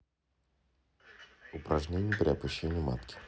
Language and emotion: Russian, neutral